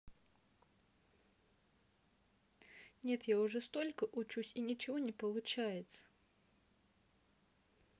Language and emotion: Russian, sad